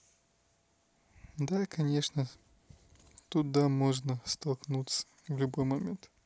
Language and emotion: Russian, neutral